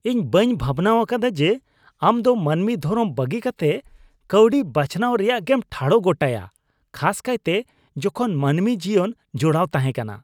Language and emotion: Santali, disgusted